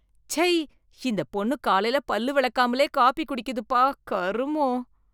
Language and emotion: Tamil, disgusted